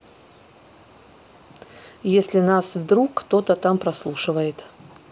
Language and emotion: Russian, neutral